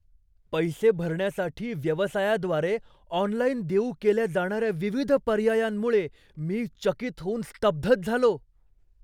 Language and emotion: Marathi, surprised